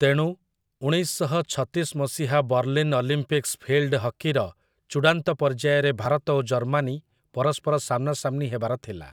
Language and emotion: Odia, neutral